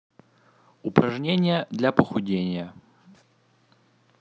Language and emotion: Russian, neutral